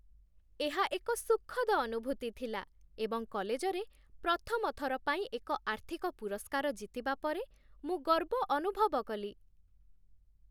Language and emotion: Odia, happy